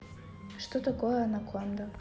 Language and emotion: Russian, neutral